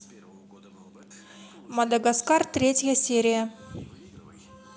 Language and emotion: Russian, neutral